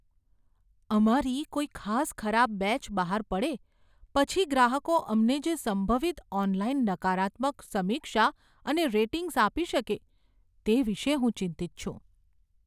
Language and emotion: Gujarati, fearful